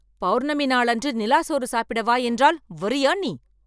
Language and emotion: Tamil, angry